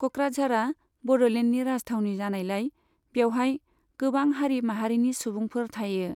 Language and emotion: Bodo, neutral